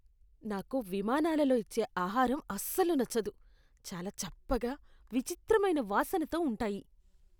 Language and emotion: Telugu, disgusted